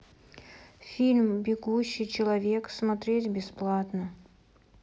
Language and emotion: Russian, neutral